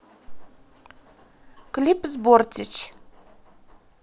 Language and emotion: Russian, neutral